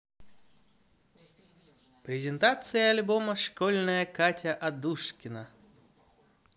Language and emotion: Russian, positive